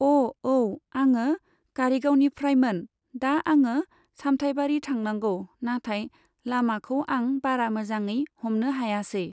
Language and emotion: Bodo, neutral